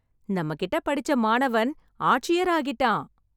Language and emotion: Tamil, happy